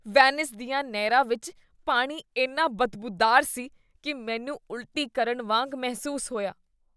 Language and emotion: Punjabi, disgusted